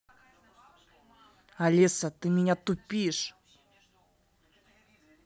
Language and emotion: Russian, angry